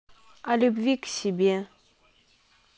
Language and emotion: Russian, neutral